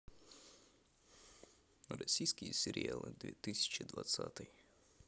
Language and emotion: Russian, neutral